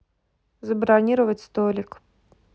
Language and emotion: Russian, neutral